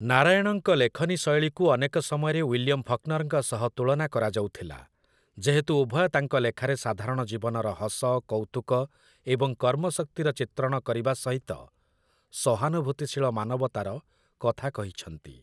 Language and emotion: Odia, neutral